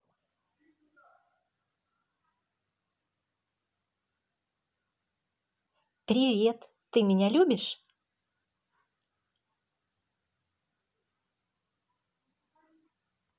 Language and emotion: Russian, positive